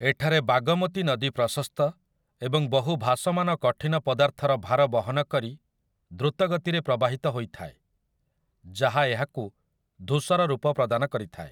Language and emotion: Odia, neutral